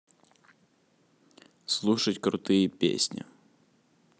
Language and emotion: Russian, neutral